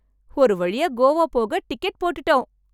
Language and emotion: Tamil, happy